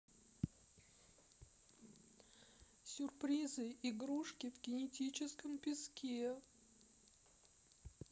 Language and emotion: Russian, sad